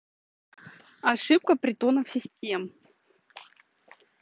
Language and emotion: Russian, neutral